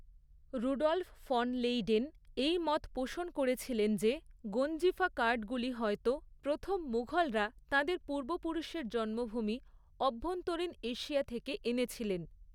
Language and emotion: Bengali, neutral